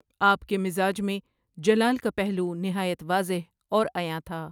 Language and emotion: Urdu, neutral